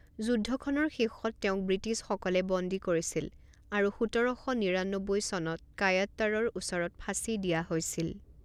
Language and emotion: Assamese, neutral